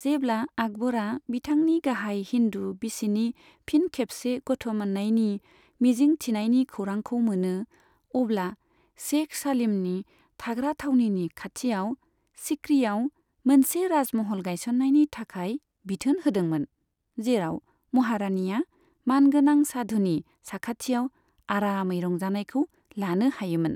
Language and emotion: Bodo, neutral